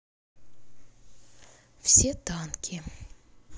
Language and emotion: Russian, sad